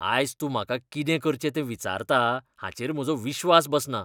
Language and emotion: Goan Konkani, disgusted